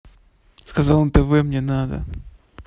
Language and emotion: Russian, neutral